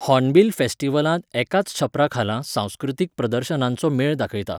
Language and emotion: Goan Konkani, neutral